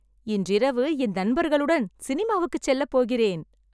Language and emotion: Tamil, happy